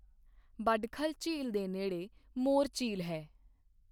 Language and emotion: Punjabi, neutral